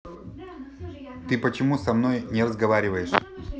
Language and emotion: Russian, neutral